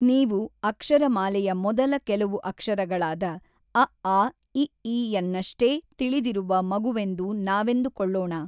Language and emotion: Kannada, neutral